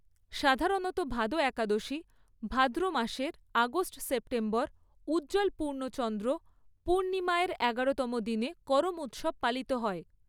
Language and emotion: Bengali, neutral